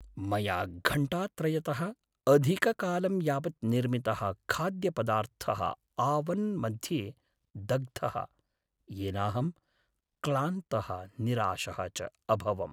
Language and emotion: Sanskrit, sad